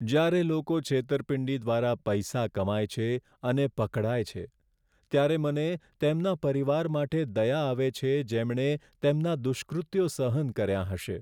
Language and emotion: Gujarati, sad